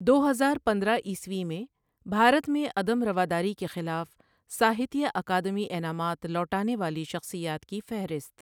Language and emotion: Urdu, neutral